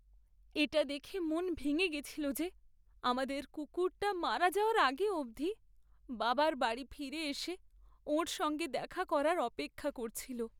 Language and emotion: Bengali, sad